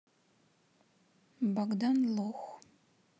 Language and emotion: Russian, neutral